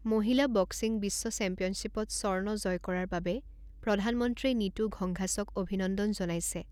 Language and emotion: Assamese, neutral